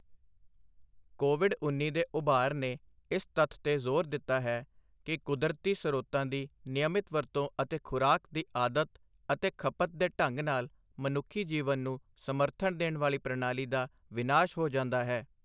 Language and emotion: Punjabi, neutral